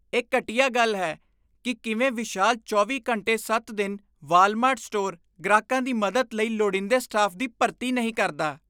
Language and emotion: Punjabi, disgusted